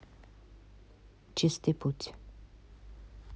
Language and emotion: Russian, neutral